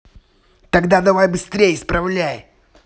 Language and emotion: Russian, angry